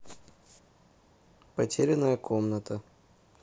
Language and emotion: Russian, neutral